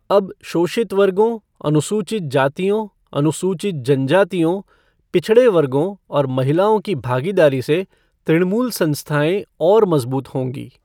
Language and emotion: Hindi, neutral